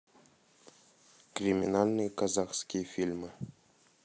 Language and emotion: Russian, neutral